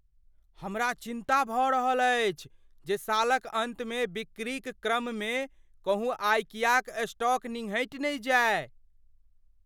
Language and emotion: Maithili, fearful